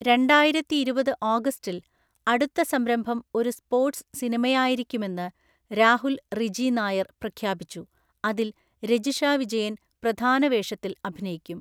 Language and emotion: Malayalam, neutral